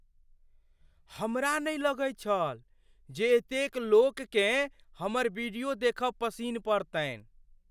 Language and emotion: Maithili, surprised